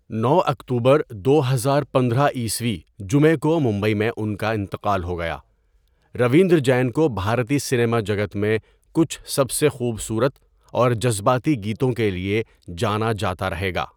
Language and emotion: Urdu, neutral